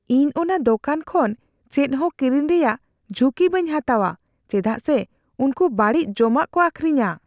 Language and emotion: Santali, fearful